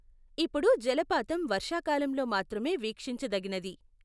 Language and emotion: Telugu, neutral